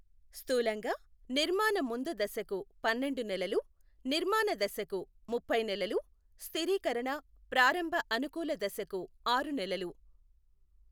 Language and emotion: Telugu, neutral